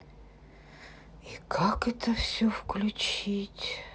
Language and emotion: Russian, sad